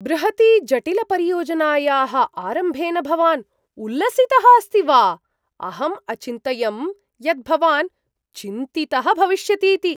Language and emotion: Sanskrit, surprised